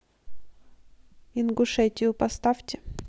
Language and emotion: Russian, neutral